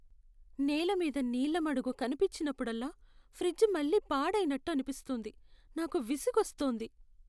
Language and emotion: Telugu, sad